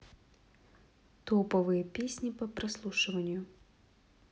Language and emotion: Russian, neutral